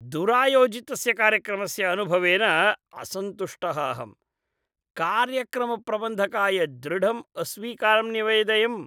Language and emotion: Sanskrit, disgusted